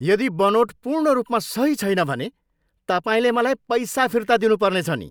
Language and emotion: Nepali, angry